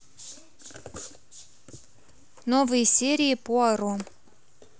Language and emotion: Russian, neutral